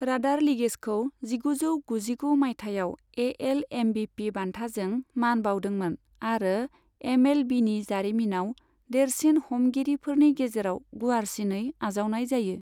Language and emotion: Bodo, neutral